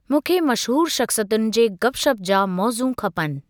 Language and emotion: Sindhi, neutral